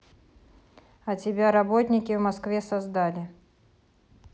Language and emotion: Russian, neutral